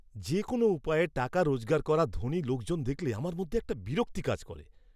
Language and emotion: Bengali, disgusted